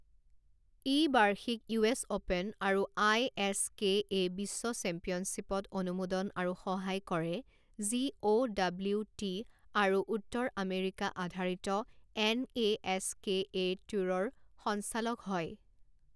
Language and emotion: Assamese, neutral